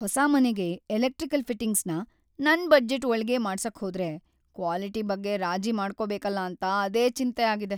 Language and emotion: Kannada, sad